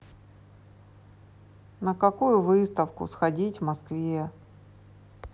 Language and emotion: Russian, sad